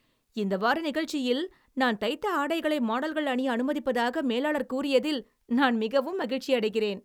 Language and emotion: Tamil, happy